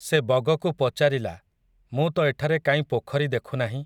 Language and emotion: Odia, neutral